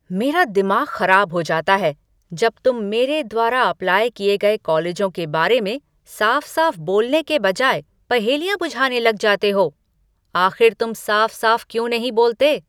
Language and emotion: Hindi, angry